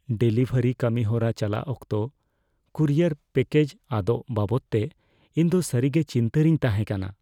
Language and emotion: Santali, fearful